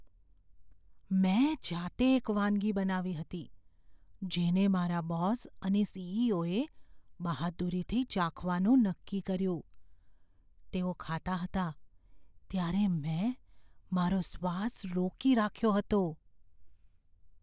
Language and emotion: Gujarati, fearful